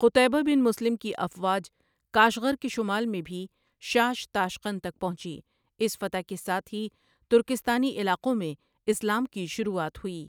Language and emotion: Urdu, neutral